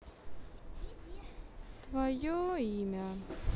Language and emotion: Russian, sad